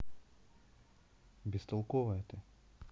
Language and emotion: Russian, neutral